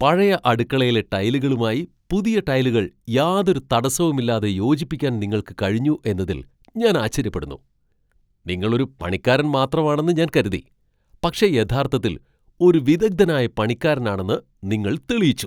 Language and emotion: Malayalam, surprised